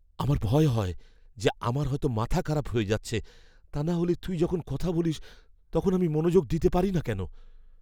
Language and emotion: Bengali, fearful